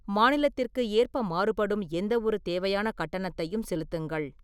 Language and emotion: Tamil, neutral